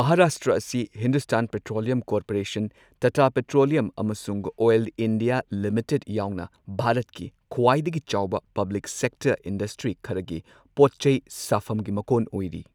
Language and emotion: Manipuri, neutral